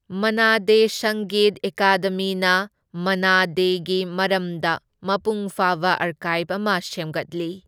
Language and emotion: Manipuri, neutral